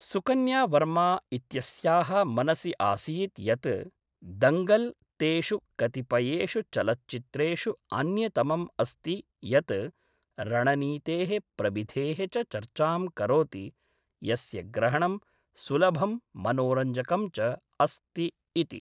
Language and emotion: Sanskrit, neutral